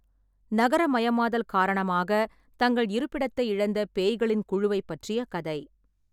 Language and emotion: Tamil, neutral